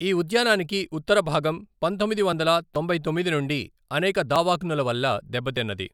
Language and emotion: Telugu, neutral